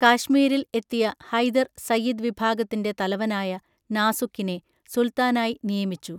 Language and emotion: Malayalam, neutral